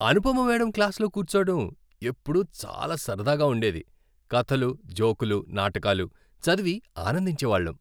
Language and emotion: Telugu, happy